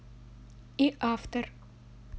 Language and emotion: Russian, neutral